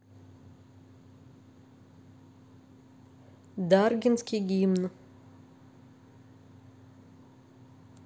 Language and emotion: Russian, neutral